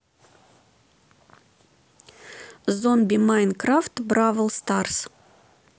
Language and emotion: Russian, neutral